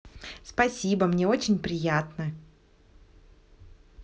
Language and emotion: Russian, positive